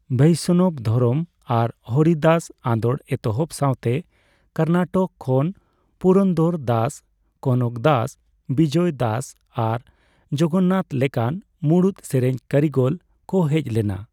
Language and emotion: Santali, neutral